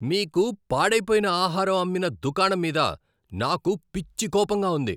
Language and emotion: Telugu, angry